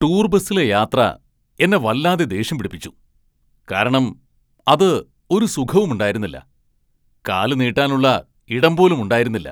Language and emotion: Malayalam, angry